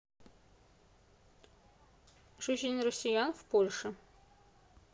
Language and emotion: Russian, neutral